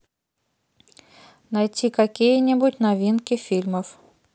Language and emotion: Russian, neutral